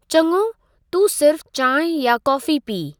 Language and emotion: Sindhi, neutral